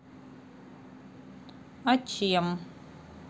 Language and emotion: Russian, neutral